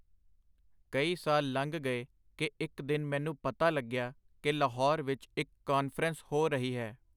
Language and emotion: Punjabi, neutral